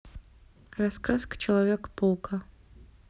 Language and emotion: Russian, neutral